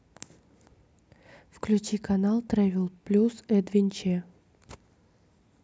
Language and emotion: Russian, neutral